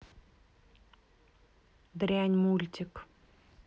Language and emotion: Russian, angry